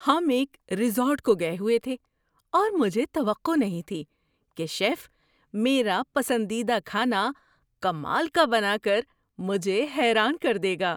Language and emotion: Urdu, surprised